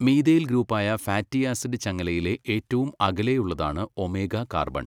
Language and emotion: Malayalam, neutral